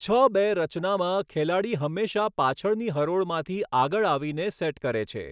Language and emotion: Gujarati, neutral